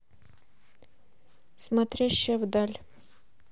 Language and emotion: Russian, neutral